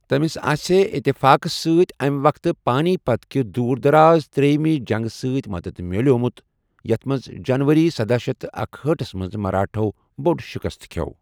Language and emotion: Kashmiri, neutral